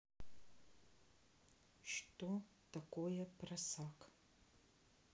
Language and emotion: Russian, neutral